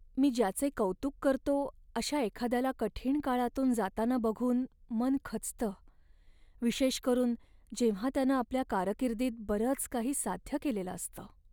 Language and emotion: Marathi, sad